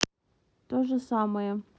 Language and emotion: Russian, neutral